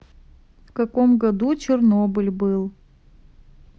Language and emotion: Russian, neutral